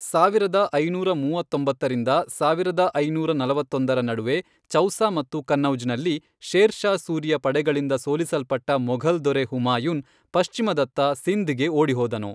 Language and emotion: Kannada, neutral